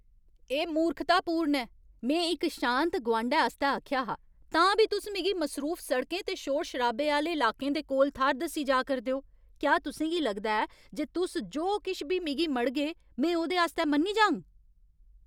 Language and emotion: Dogri, angry